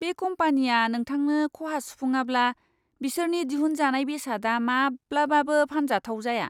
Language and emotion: Bodo, disgusted